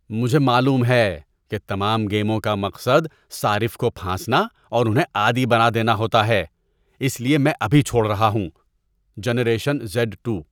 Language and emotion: Urdu, disgusted